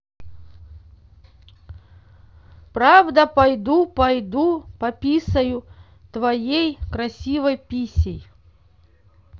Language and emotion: Russian, neutral